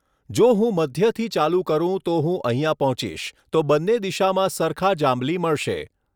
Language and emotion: Gujarati, neutral